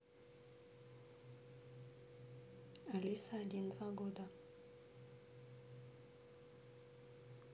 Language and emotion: Russian, neutral